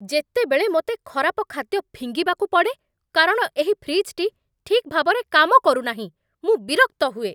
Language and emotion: Odia, angry